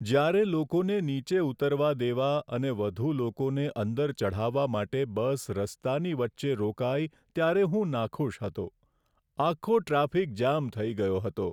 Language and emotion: Gujarati, sad